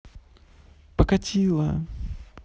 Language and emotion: Russian, neutral